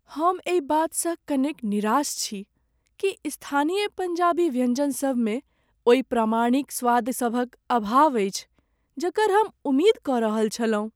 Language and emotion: Maithili, sad